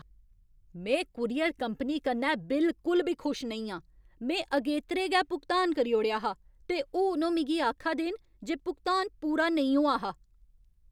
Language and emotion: Dogri, angry